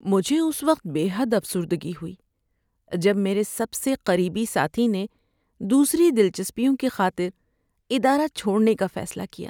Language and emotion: Urdu, sad